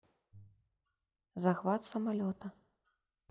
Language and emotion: Russian, neutral